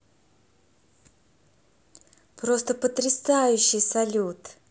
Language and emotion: Russian, positive